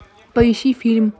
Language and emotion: Russian, neutral